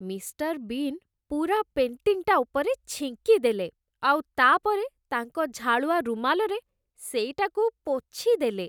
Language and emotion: Odia, disgusted